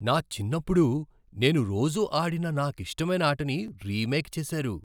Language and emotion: Telugu, surprised